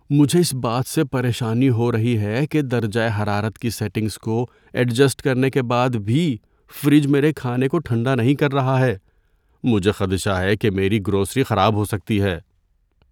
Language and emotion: Urdu, fearful